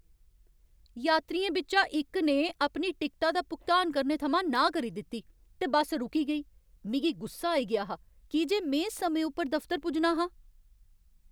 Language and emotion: Dogri, angry